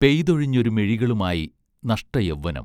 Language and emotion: Malayalam, neutral